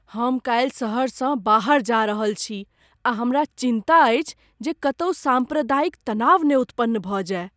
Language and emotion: Maithili, fearful